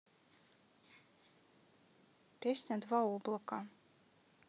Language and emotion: Russian, neutral